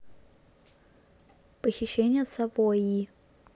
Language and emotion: Russian, neutral